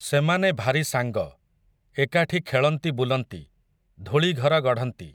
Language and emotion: Odia, neutral